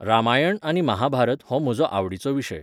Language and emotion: Goan Konkani, neutral